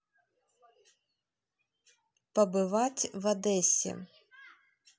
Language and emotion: Russian, neutral